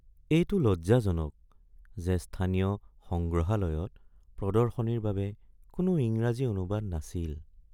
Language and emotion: Assamese, sad